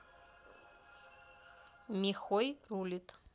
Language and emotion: Russian, neutral